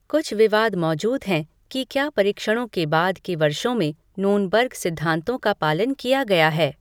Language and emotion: Hindi, neutral